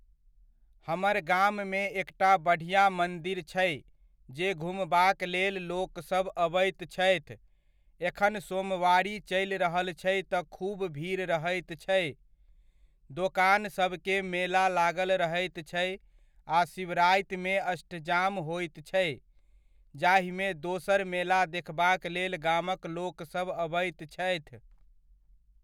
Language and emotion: Maithili, neutral